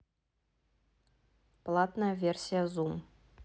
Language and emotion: Russian, neutral